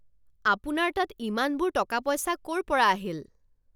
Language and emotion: Assamese, angry